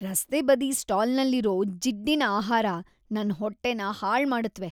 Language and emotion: Kannada, disgusted